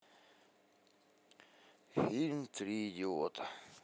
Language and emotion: Russian, neutral